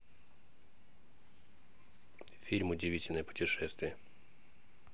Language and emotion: Russian, neutral